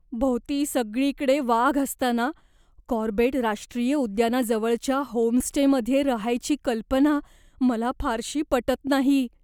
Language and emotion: Marathi, fearful